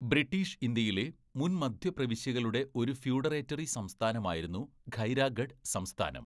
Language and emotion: Malayalam, neutral